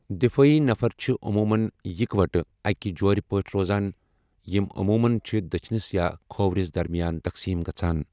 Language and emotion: Kashmiri, neutral